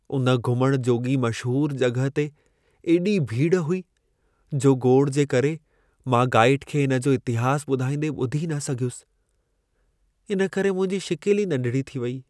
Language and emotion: Sindhi, sad